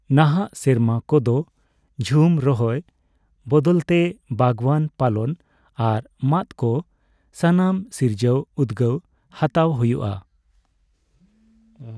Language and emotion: Santali, neutral